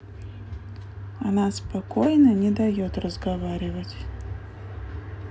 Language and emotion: Russian, neutral